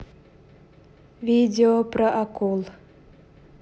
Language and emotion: Russian, neutral